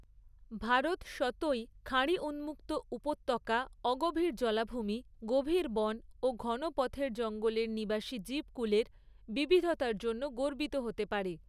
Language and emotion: Bengali, neutral